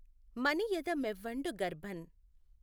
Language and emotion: Telugu, neutral